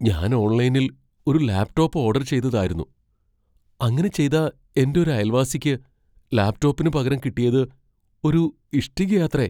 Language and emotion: Malayalam, fearful